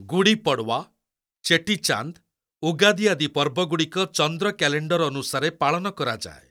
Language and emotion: Odia, neutral